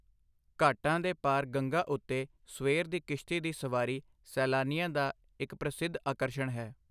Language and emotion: Punjabi, neutral